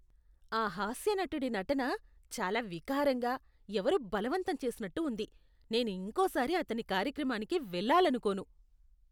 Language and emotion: Telugu, disgusted